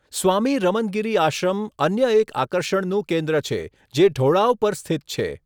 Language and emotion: Gujarati, neutral